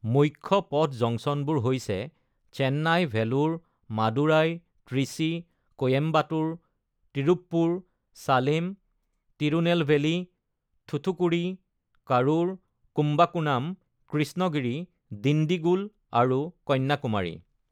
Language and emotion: Assamese, neutral